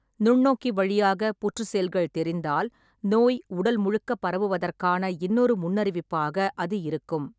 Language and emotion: Tamil, neutral